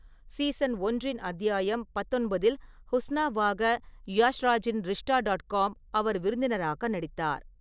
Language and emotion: Tamil, neutral